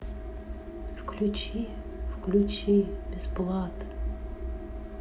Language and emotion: Russian, neutral